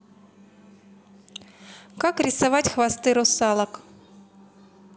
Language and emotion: Russian, neutral